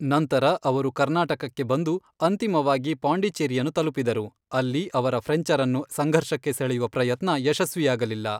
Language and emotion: Kannada, neutral